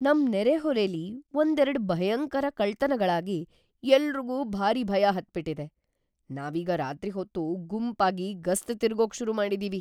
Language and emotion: Kannada, fearful